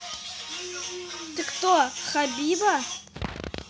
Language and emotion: Russian, neutral